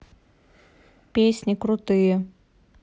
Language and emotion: Russian, neutral